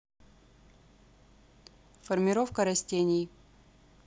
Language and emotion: Russian, neutral